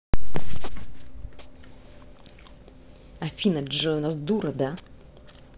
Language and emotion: Russian, angry